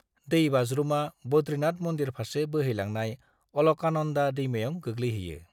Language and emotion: Bodo, neutral